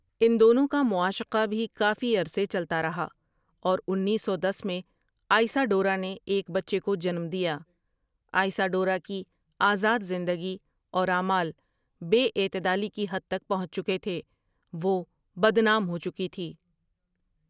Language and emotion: Urdu, neutral